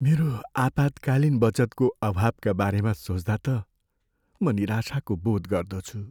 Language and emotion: Nepali, sad